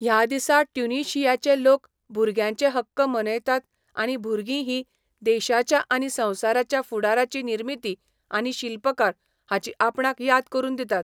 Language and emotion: Goan Konkani, neutral